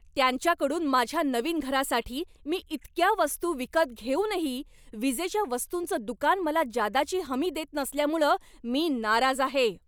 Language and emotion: Marathi, angry